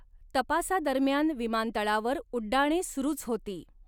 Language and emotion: Marathi, neutral